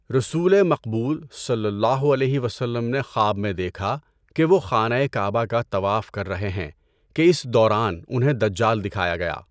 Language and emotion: Urdu, neutral